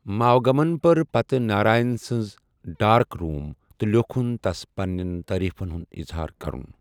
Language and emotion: Kashmiri, neutral